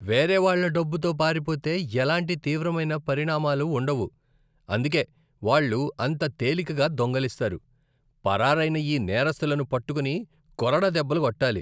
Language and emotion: Telugu, disgusted